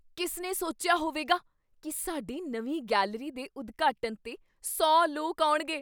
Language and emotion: Punjabi, surprised